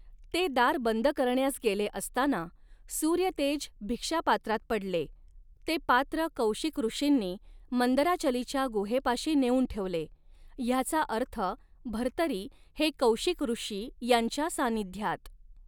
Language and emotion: Marathi, neutral